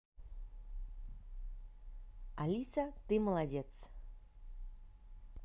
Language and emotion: Russian, positive